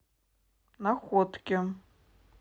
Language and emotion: Russian, neutral